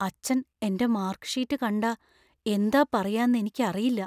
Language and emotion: Malayalam, fearful